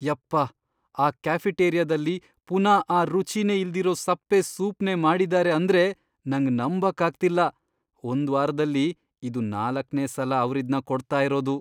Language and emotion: Kannada, disgusted